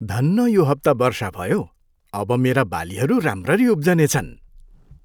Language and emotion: Nepali, happy